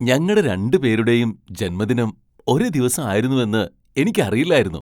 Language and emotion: Malayalam, surprised